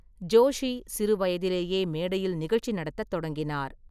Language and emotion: Tamil, neutral